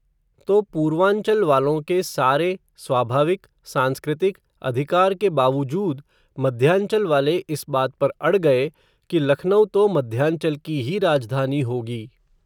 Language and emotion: Hindi, neutral